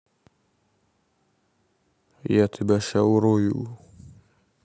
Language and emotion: Russian, angry